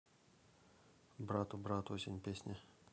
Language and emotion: Russian, neutral